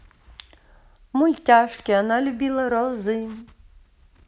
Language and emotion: Russian, positive